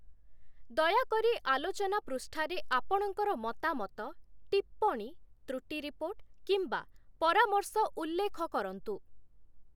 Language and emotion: Odia, neutral